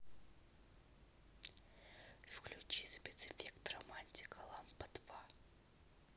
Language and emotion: Russian, neutral